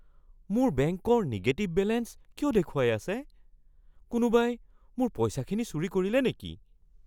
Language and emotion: Assamese, fearful